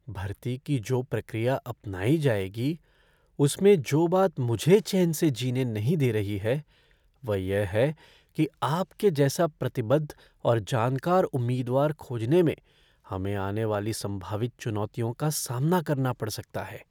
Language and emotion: Hindi, fearful